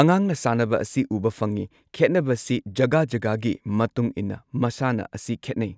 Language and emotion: Manipuri, neutral